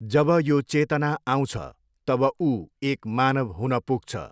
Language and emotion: Nepali, neutral